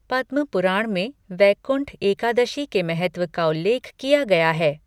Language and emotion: Hindi, neutral